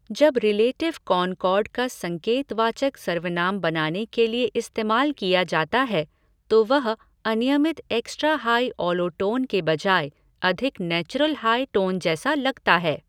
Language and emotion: Hindi, neutral